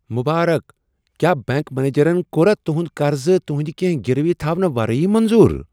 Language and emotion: Kashmiri, surprised